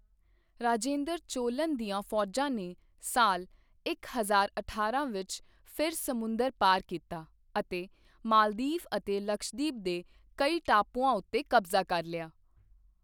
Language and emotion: Punjabi, neutral